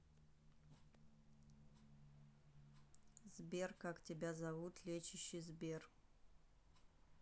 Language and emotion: Russian, neutral